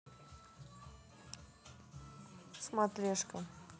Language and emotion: Russian, neutral